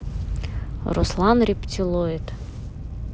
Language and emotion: Russian, neutral